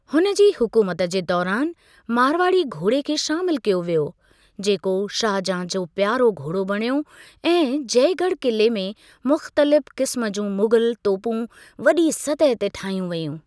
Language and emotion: Sindhi, neutral